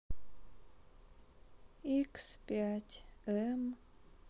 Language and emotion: Russian, sad